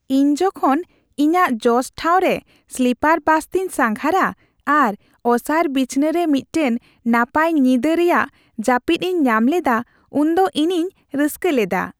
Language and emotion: Santali, happy